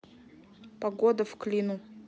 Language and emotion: Russian, neutral